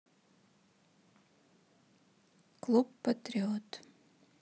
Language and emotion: Russian, neutral